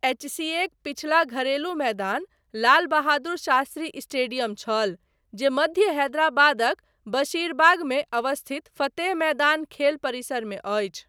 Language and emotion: Maithili, neutral